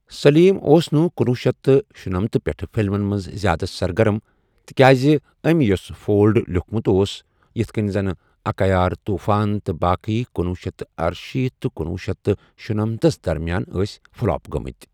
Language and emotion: Kashmiri, neutral